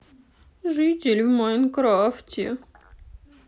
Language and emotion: Russian, sad